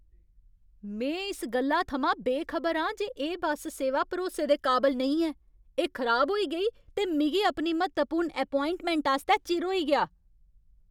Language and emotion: Dogri, angry